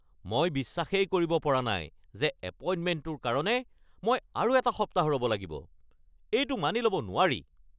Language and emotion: Assamese, angry